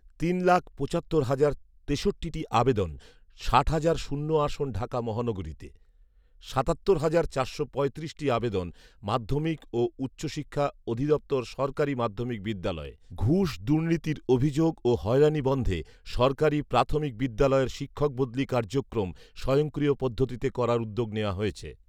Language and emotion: Bengali, neutral